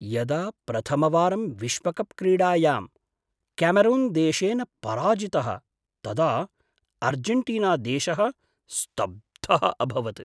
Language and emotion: Sanskrit, surprised